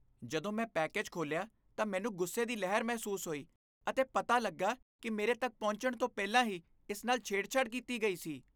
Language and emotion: Punjabi, disgusted